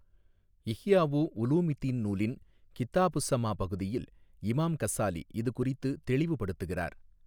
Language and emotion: Tamil, neutral